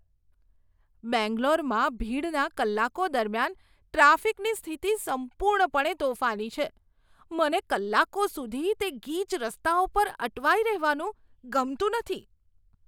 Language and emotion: Gujarati, disgusted